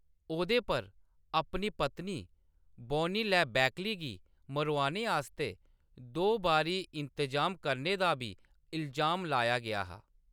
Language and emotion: Dogri, neutral